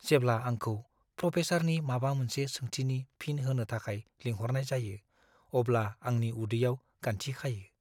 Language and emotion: Bodo, fearful